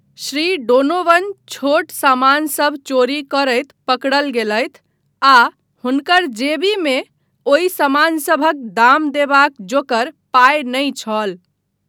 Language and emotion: Maithili, neutral